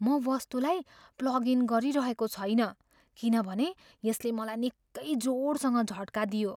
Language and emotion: Nepali, fearful